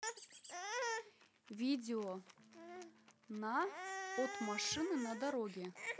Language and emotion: Russian, neutral